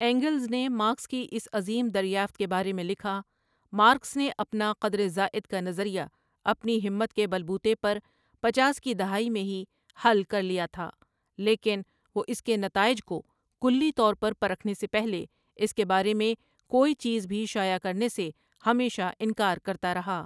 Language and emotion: Urdu, neutral